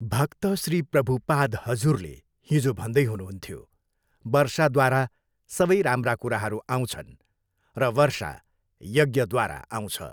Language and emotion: Nepali, neutral